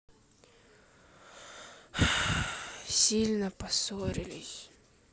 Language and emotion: Russian, sad